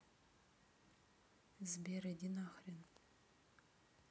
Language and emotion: Russian, neutral